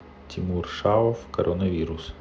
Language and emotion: Russian, neutral